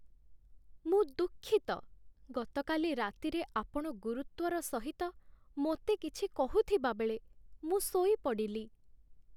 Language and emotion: Odia, sad